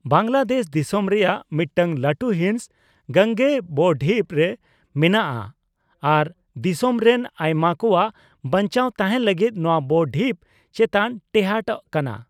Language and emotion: Santali, neutral